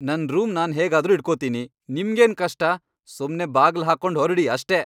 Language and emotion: Kannada, angry